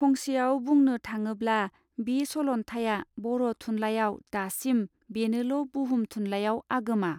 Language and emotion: Bodo, neutral